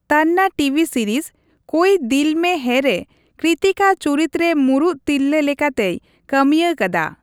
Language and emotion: Santali, neutral